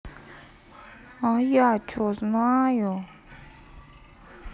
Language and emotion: Russian, sad